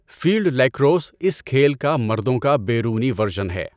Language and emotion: Urdu, neutral